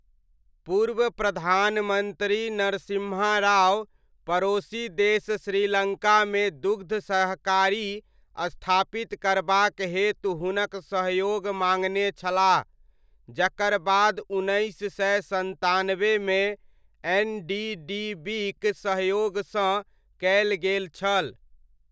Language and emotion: Maithili, neutral